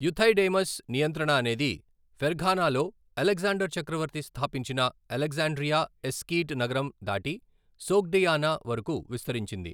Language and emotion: Telugu, neutral